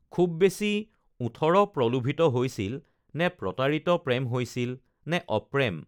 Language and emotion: Assamese, neutral